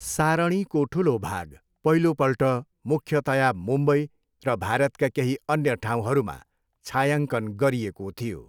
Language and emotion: Nepali, neutral